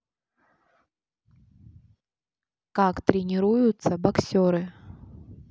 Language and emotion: Russian, neutral